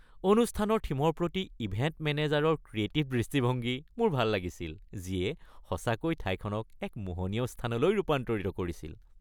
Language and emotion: Assamese, happy